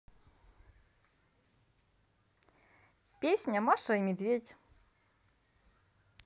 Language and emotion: Russian, positive